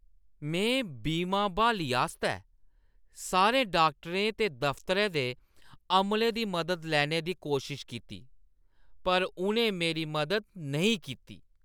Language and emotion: Dogri, disgusted